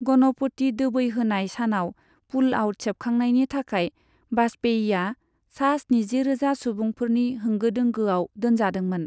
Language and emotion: Bodo, neutral